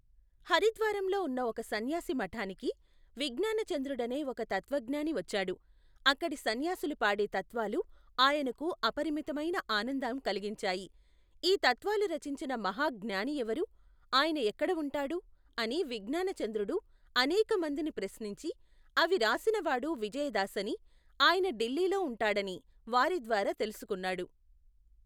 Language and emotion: Telugu, neutral